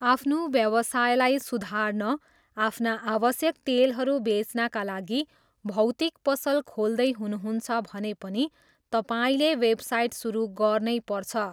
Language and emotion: Nepali, neutral